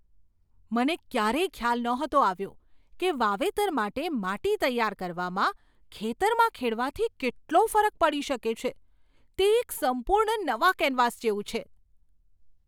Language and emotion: Gujarati, surprised